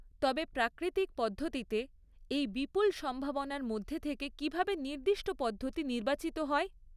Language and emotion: Bengali, neutral